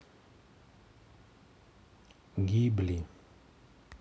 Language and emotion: Russian, neutral